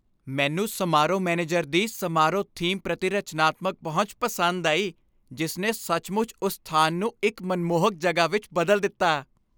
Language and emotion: Punjabi, happy